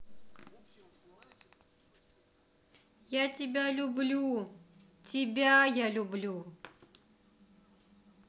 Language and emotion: Russian, positive